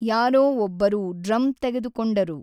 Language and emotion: Kannada, neutral